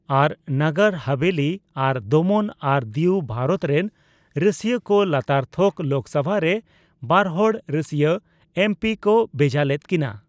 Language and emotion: Santali, neutral